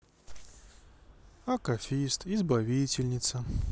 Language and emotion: Russian, sad